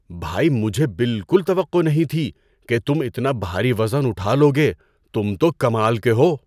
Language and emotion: Urdu, surprised